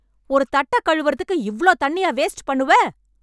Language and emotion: Tamil, angry